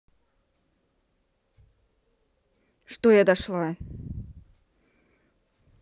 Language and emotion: Russian, angry